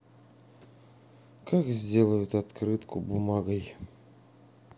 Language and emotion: Russian, sad